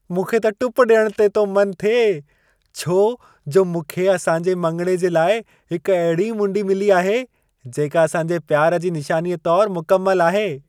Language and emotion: Sindhi, happy